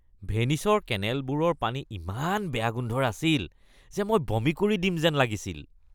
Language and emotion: Assamese, disgusted